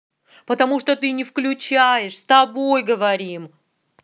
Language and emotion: Russian, angry